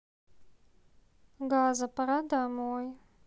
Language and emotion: Russian, sad